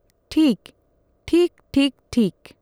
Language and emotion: Santali, neutral